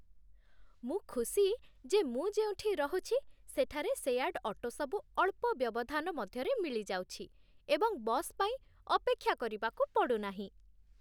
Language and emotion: Odia, happy